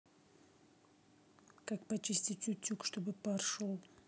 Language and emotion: Russian, neutral